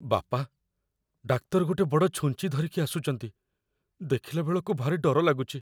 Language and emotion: Odia, fearful